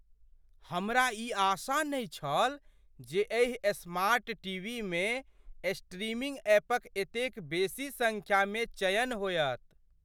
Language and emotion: Maithili, surprised